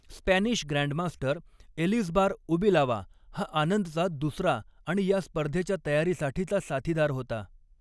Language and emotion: Marathi, neutral